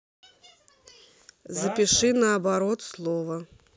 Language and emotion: Russian, neutral